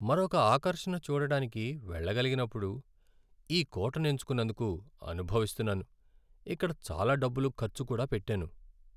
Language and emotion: Telugu, sad